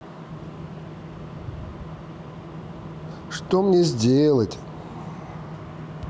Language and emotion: Russian, neutral